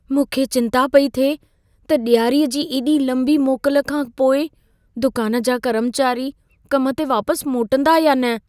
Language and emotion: Sindhi, fearful